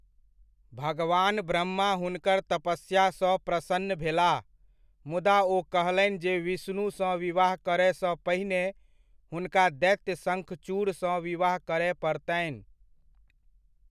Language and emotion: Maithili, neutral